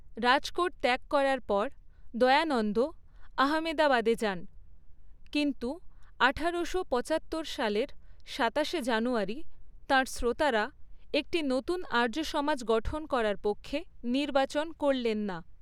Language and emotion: Bengali, neutral